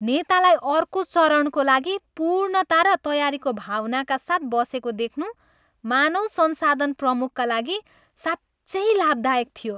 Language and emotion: Nepali, happy